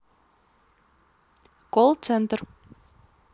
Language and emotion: Russian, neutral